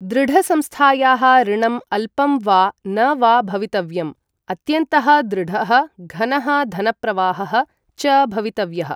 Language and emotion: Sanskrit, neutral